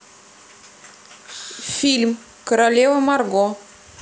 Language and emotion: Russian, neutral